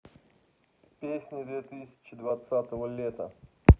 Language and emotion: Russian, neutral